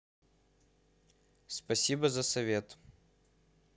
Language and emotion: Russian, neutral